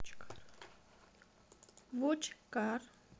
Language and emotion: Russian, neutral